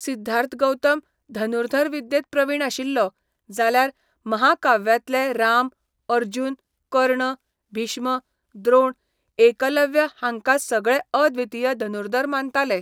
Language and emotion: Goan Konkani, neutral